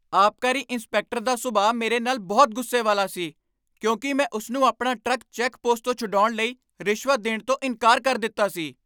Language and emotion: Punjabi, angry